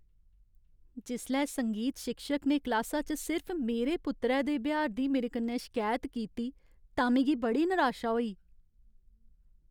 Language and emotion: Dogri, sad